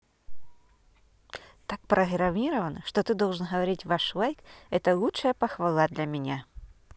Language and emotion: Russian, neutral